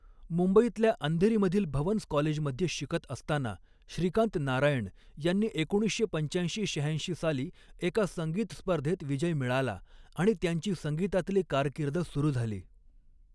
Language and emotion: Marathi, neutral